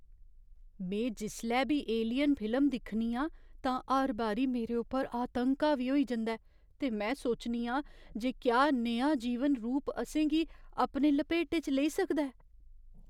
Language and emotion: Dogri, fearful